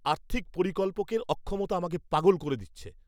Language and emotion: Bengali, angry